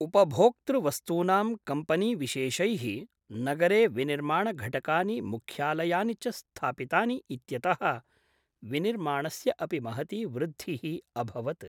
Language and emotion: Sanskrit, neutral